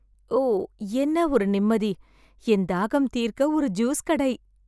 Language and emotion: Tamil, happy